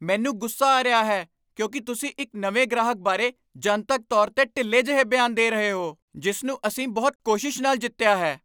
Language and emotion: Punjabi, angry